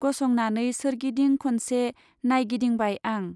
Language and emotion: Bodo, neutral